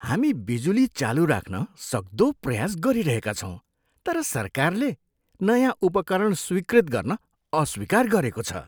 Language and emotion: Nepali, disgusted